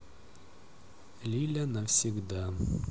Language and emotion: Russian, neutral